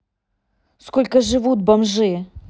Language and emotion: Russian, angry